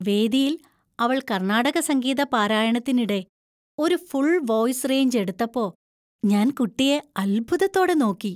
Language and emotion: Malayalam, happy